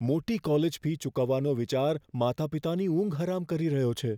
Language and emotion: Gujarati, fearful